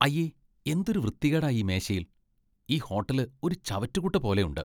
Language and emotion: Malayalam, disgusted